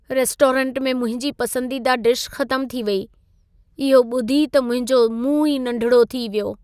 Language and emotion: Sindhi, sad